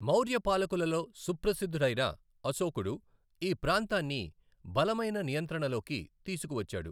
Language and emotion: Telugu, neutral